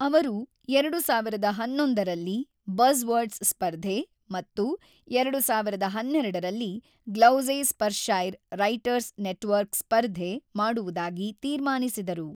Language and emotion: Kannada, neutral